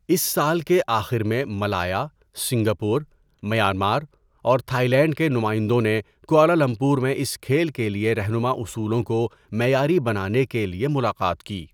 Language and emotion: Urdu, neutral